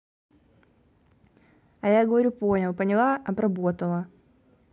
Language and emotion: Russian, angry